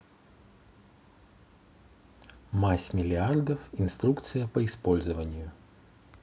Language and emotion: Russian, neutral